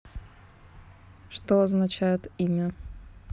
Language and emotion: Russian, neutral